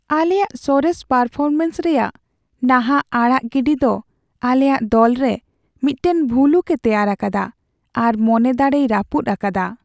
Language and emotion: Santali, sad